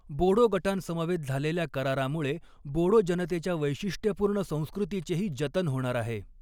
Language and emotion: Marathi, neutral